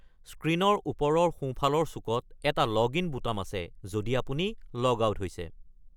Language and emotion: Assamese, neutral